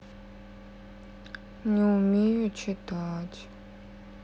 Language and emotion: Russian, sad